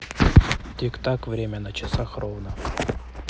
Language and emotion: Russian, neutral